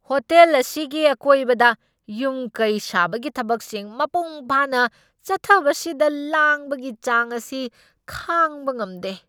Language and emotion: Manipuri, angry